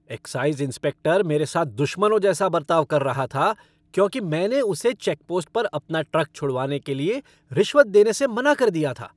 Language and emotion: Hindi, angry